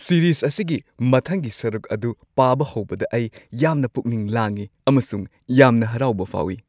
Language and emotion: Manipuri, happy